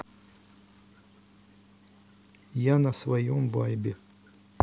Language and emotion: Russian, sad